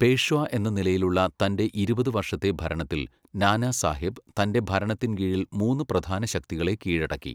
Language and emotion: Malayalam, neutral